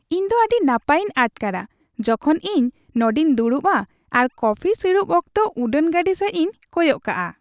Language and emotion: Santali, happy